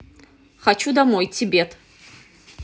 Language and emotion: Russian, neutral